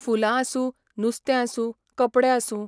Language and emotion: Goan Konkani, neutral